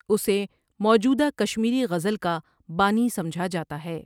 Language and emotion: Urdu, neutral